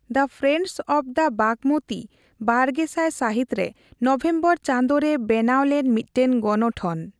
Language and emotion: Santali, neutral